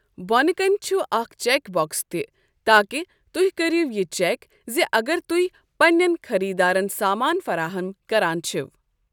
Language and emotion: Kashmiri, neutral